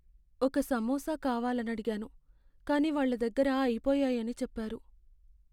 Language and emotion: Telugu, sad